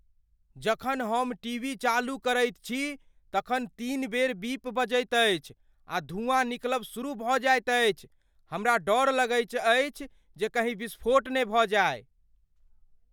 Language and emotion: Maithili, fearful